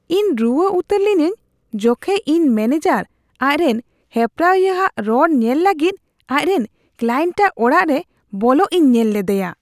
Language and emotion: Santali, disgusted